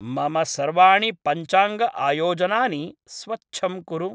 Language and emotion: Sanskrit, neutral